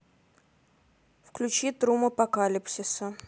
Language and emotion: Russian, neutral